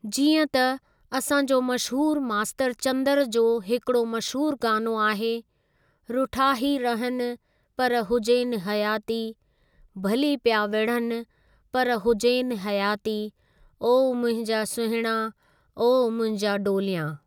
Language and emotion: Sindhi, neutral